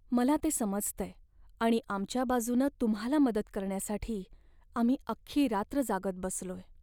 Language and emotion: Marathi, sad